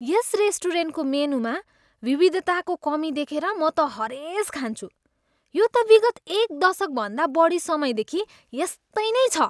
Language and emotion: Nepali, disgusted